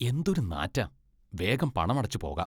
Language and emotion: Malayalam, disgusted